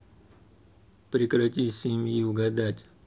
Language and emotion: Russian, neutral